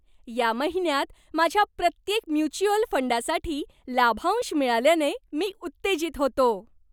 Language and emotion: Marathi, happy